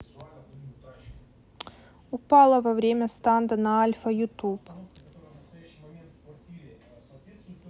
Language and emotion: Russian, neutral